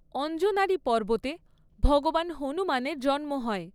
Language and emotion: Bengali, neutral